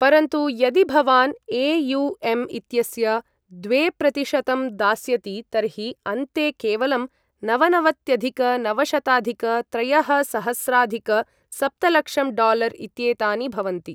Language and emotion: Sanskrit, neutral